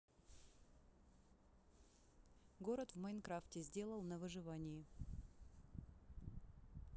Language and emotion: Russian, neutral